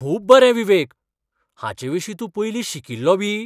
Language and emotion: Goan Konkani, surprised